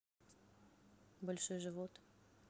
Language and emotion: Russian, neutral